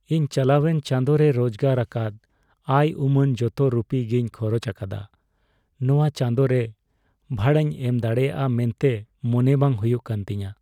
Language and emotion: Santali, sad